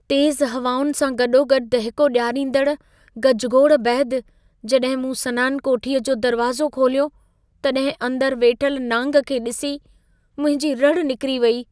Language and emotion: Sindhi, fearful